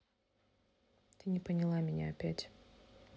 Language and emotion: Russian, neutral